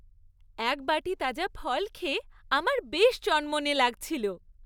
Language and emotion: Bengali, happy